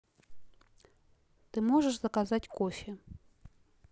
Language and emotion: Russian, neutral